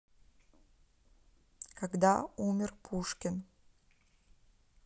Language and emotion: Russian, neutral